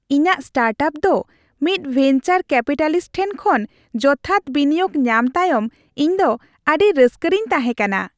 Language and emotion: Santali, happy